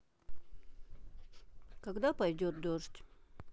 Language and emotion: Russian, neutral